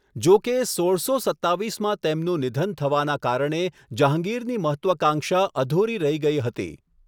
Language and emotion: Gujarati, neutral